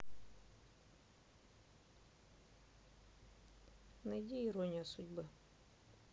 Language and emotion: Russian, neutral